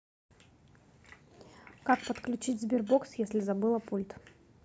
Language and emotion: Russian, neutral